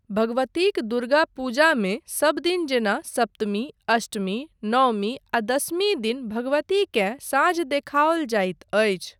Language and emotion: Maithili, neutral